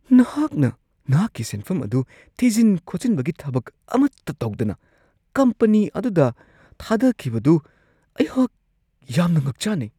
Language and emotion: Manipuri, surprised